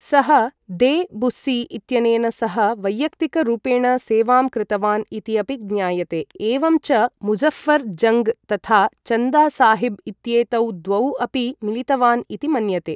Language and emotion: Sanskrit, neutral